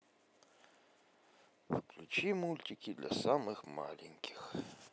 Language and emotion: Russian, positive